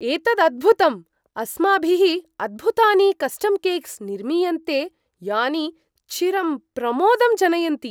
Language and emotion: Sanskrit, surprised